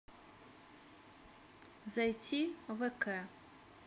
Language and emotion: Russian, neutral